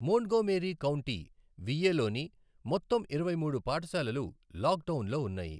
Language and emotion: Telugu, neutral